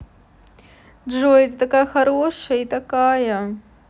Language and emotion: Russian, positive